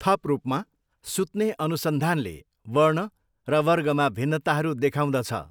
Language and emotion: Nepali, neutral